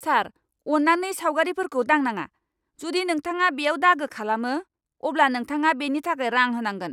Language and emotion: Bodo, angry